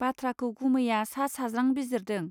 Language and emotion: Bodo, neutral